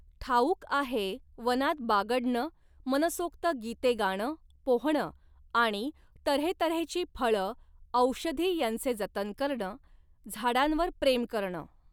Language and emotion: Marathi, neutral